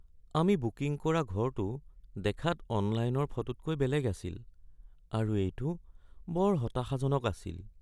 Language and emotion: Assamese, sad